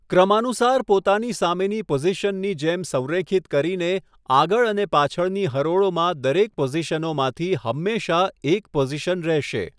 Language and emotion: Gujarati, neutral